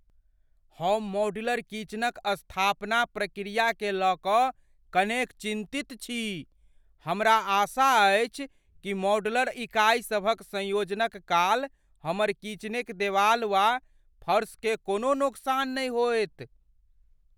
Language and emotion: Maithili, fearful